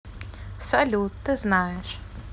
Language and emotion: Russian, neutral